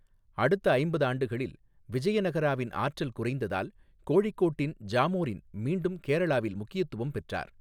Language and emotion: Tamil, neutral